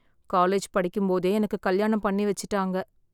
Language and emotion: Tamil, sad